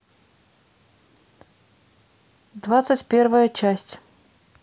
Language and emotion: Russian, neutral